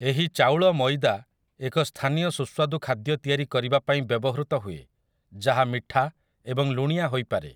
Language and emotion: Odia, neutral